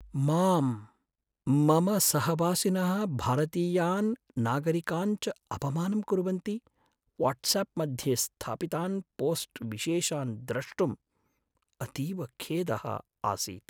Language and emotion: Sanskrit, sad